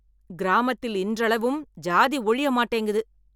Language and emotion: Tamil, angry